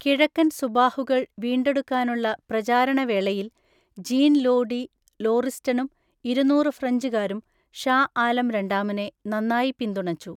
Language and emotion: Malayalam, neutral